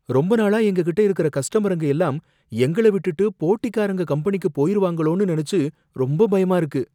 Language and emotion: Tamil, fearful